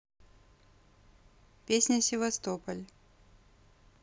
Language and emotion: Russian, neutral